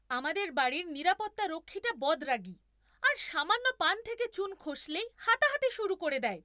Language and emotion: Bengali, angry